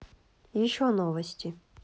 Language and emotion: Russian, neutral